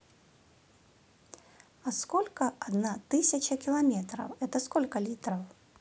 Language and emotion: Russian, neutral